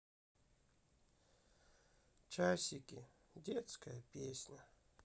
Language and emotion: Russian, sad